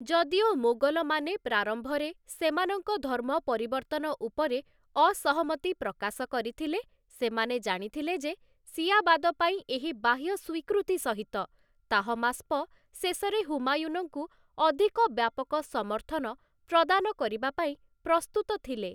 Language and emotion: Odia, neutral